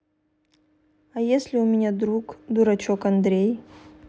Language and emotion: Russian, neutral